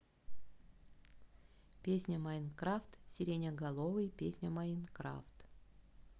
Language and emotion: Russian, neutral